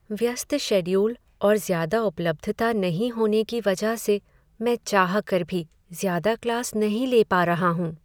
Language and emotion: Hindi, sad